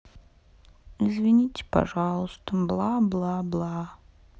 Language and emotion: Russian, sad